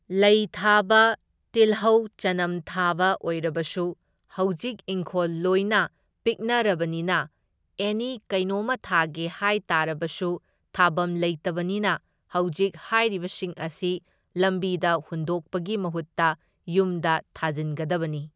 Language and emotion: Manipuri, neutral